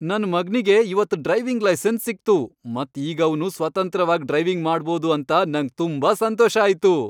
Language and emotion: Kannada, happy